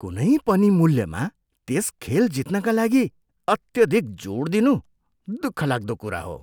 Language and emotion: Nepali, disgusted